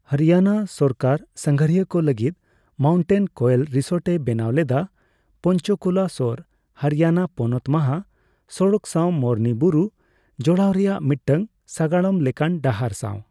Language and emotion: Santali, neutral